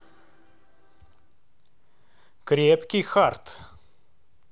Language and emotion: Russian, neutral